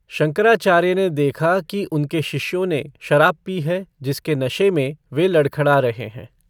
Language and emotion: Hindi, neutral